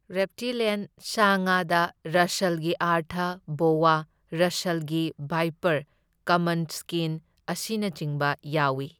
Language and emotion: Manipuri, neutral